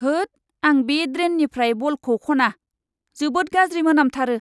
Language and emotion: Bodo, disgusted